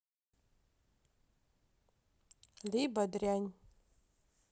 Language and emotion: Russian, neutral